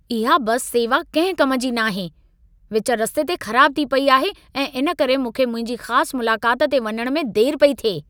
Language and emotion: Sindhi, angry